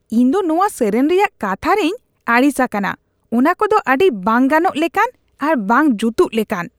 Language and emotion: Santali, disgusted